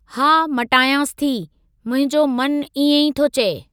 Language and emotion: Sindhi, neutral